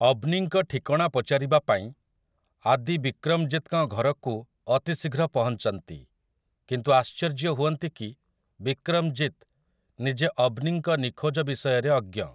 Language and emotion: Odia, neutral